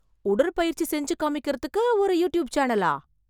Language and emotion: Tamil, surprised